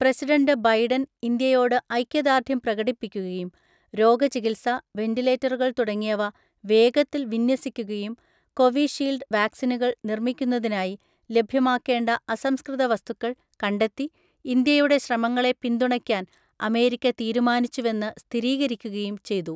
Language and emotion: Malayalam, neutral